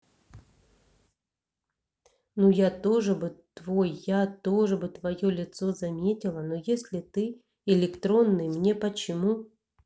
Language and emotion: Russian, neutral